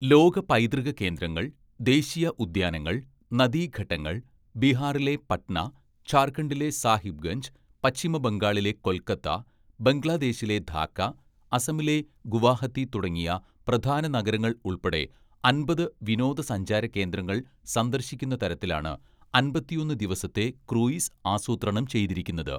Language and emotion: Malayalam, neutral